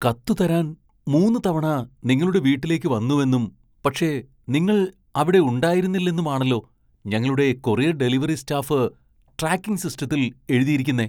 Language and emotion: Malayalam, surprised